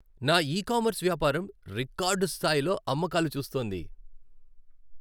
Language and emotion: Telugu, happy